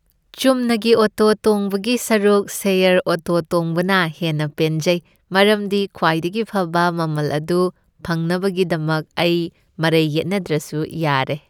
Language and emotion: Manipuri, happy